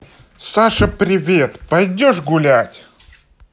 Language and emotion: Russian, positive